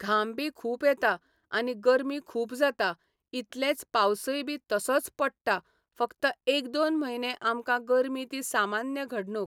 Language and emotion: Goan Konkani, neutral